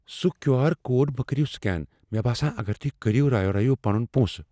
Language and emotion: Kashmiri, fearful